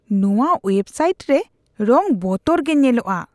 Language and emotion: Santali, disgusted